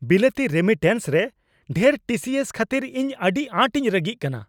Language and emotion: Santali, angry